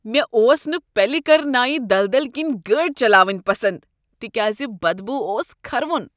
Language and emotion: Kashmiri, disgusted